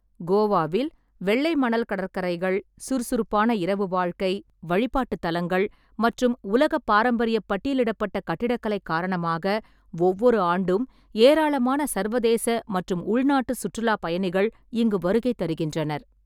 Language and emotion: Tamil, neutral